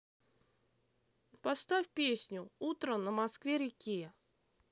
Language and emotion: Russian, neutral